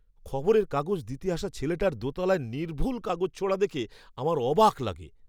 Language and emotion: Bengali, surprised